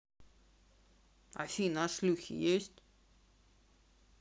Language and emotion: Russian, neutral